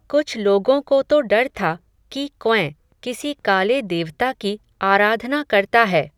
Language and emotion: Hindi, neutral